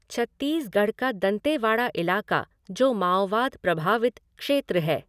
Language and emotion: Hindi, neutral